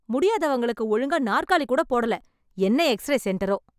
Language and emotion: Tamil, angry